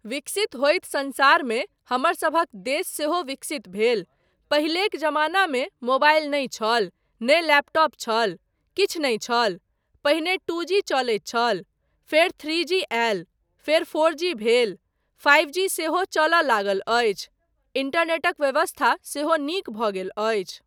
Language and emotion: Maithili, neutral